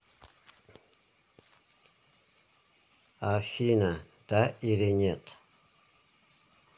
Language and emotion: Russian, neutral